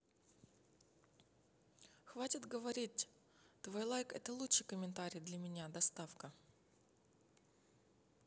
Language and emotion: Russian, neutral